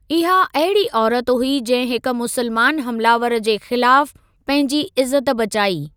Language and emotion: Sindhi, neutral